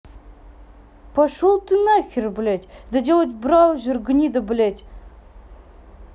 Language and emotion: Russian, angry